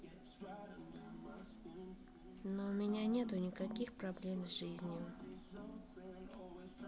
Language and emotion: Russian, neutral